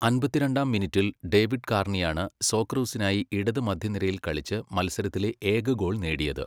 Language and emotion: Malayalam, neutral